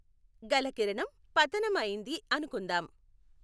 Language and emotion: Telugu, neutral